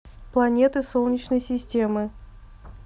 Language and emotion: Russian, neutral